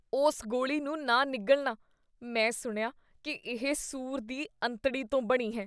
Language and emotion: Punjabi, disgusted